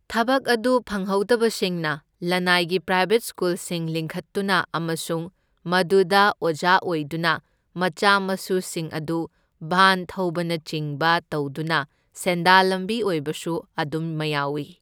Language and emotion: Manipuri, neutral